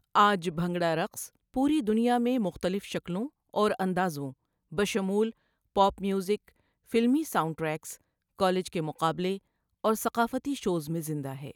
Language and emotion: Urdu, neutral